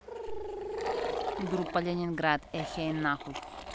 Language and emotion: Russian, neutral